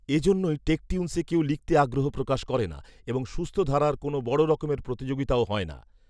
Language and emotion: Bengali, neutral